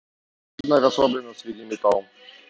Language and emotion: Russian, neutral